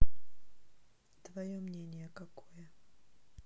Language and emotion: Russian, neutral